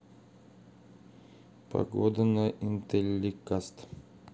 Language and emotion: Russian, neutral